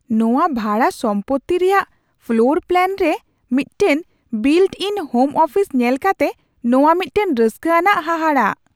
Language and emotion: Santali, surprised